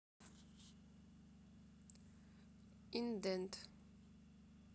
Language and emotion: Russian, neutral